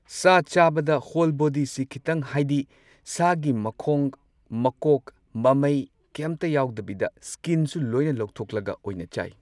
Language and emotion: Manipuri, neutral